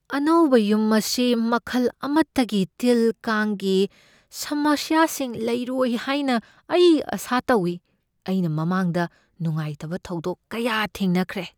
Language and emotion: Manipuri, fearful